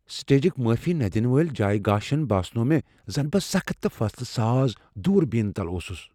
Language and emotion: Kashmiri, fearful